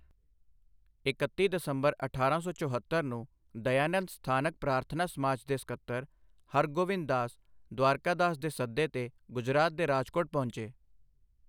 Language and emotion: Punjabi, neutral